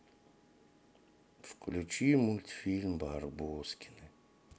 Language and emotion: Russian, sad